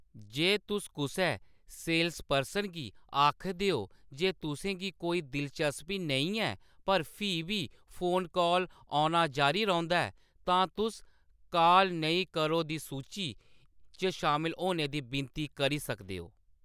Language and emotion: Dogri, neutral